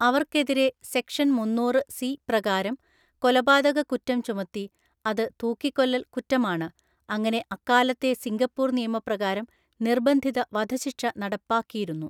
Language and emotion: Malayalam, neutral